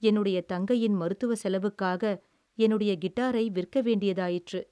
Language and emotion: Tamil, sad